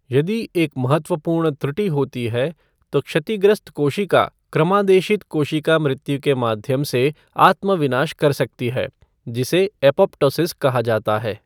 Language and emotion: Hindi, neutral